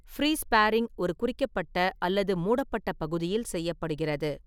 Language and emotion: Tamil, neutral